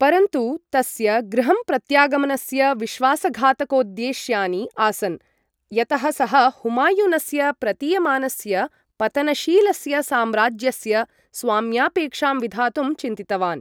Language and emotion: Sanskrit, neutral